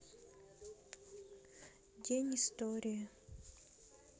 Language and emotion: Russian, sad